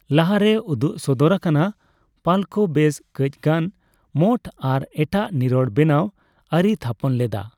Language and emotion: Santali, neutral